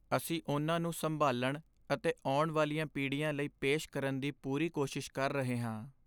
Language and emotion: Punjabi, sad